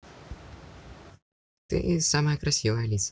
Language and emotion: Russian, positive